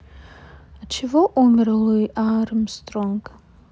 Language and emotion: Russian, neutral